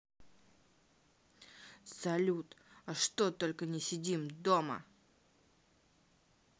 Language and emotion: Russian, angry